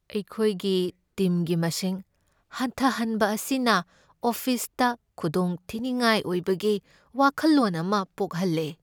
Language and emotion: Manipuri, sad